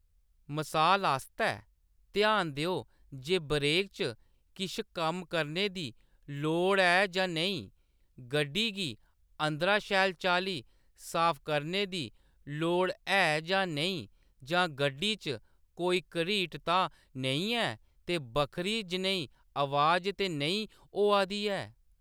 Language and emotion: Dogri, neutral